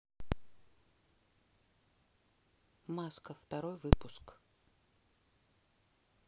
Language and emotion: Russian, neutral